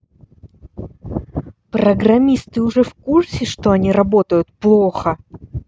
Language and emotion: Russian, angry